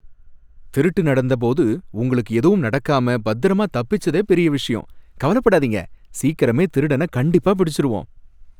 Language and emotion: Tamil, happy